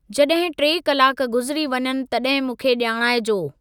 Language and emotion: Sindhi, neutral